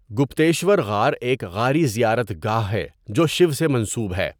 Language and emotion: Urdu, neutral